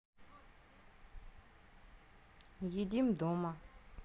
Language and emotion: Russian, neutral